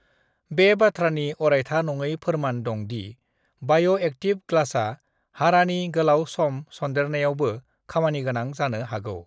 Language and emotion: Bodo, neutral